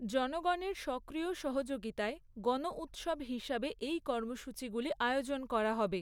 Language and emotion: Bengali, neutral